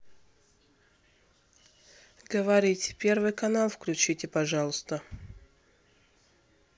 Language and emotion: Russian, neutral